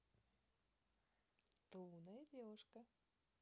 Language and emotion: Russian, positive